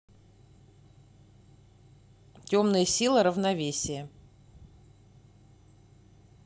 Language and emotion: Russian, neutral